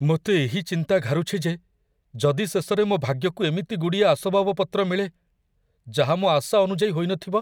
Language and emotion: Odia, fearful